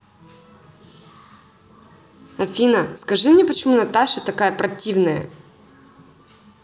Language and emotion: Russian, angry